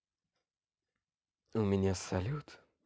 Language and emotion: Russian, positive